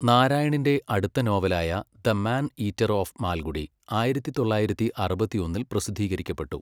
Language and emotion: Malayalam, neutral